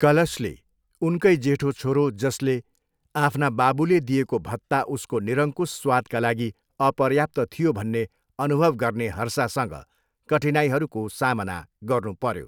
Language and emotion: Nepali, neutral